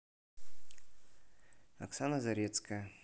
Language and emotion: Russian, neutral